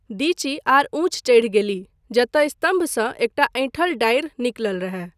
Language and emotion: Maithili, neutral